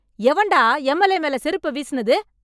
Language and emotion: Tamil, angry